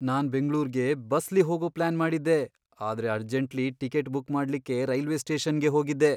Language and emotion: Kannada, fearful